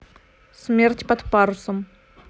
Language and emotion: Russian, neutral